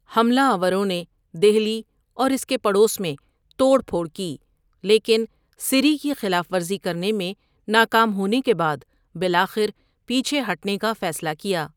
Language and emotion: Urdu, neutral